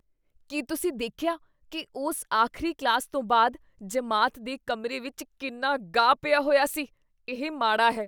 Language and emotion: Punjabi, disgusted